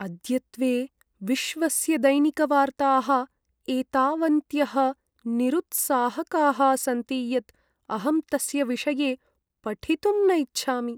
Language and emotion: Sanskrit, sad